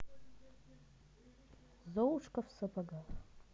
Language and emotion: Russian, neutral